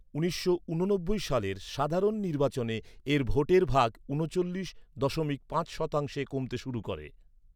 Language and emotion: Bengali, neutral